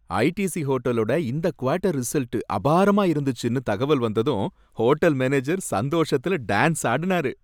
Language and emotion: Tamil, happy